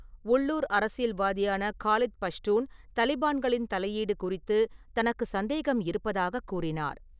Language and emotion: Tamil, neutral